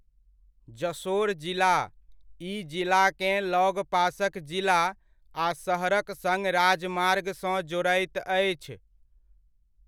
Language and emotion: Maithili, neutral